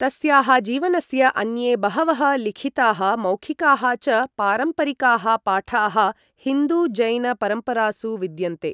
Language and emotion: Sanskrit, neutral